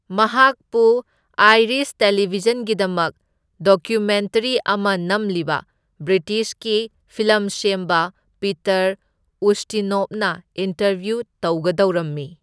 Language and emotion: Manipuri, neutral